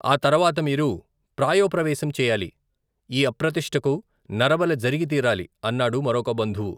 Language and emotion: Telugu, neutral